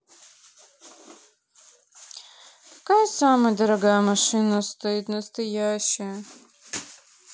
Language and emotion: Russian, sad